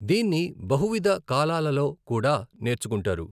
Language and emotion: Telugu, neutral